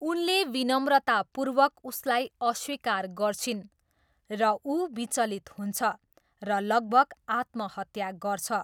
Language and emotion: Nepali, neutral